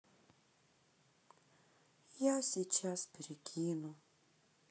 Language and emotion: Russian, sad